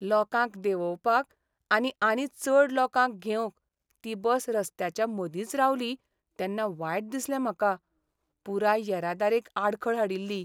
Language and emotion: Goan Konkani, sad